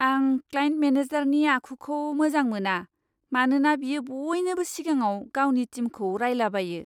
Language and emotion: Bodo, disgusted